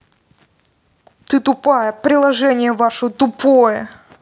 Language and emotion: Russian, angry